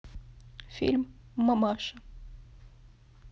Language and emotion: Russian, sad